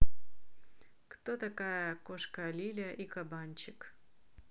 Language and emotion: Russian, neutral